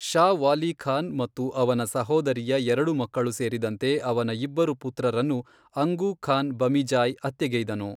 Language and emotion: Kannada, neutral